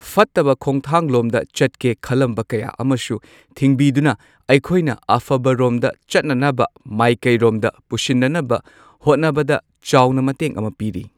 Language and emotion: Manipuri, neutral